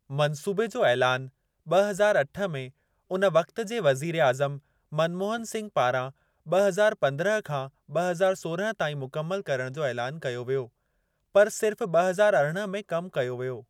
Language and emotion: Sindhi, neutral